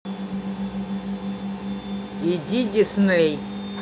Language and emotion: Russian, neutral